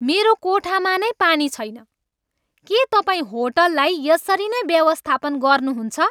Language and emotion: Nepali, angry